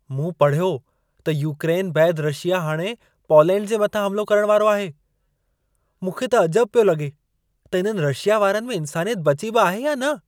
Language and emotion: Sindhi, surprised